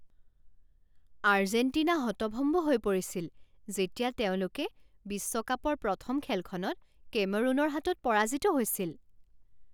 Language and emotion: Assamese, surprised